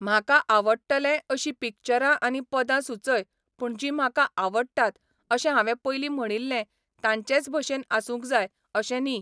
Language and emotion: Goan Konkani, neutral